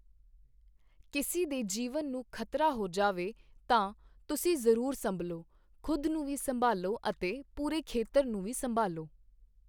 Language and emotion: Punjabi, neutral